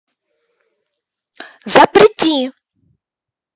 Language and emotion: Russian, angry